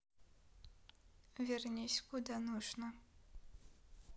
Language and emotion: Russian, neutral